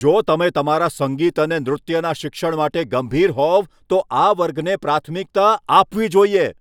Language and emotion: Gujarati, angry